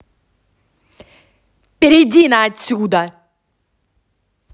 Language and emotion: Russian, angry